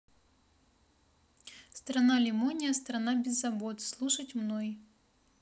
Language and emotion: Russian, neutral